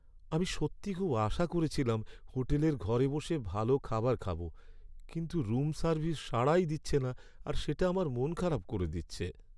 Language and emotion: Bengali, sad